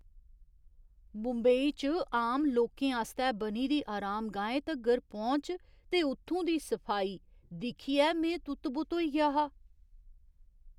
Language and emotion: Dogri, surprised